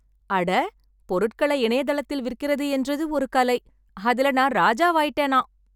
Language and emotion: Tamil, happy